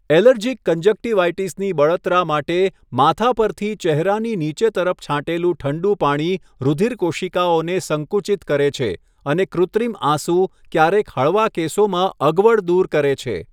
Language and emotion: Gujarati, neutral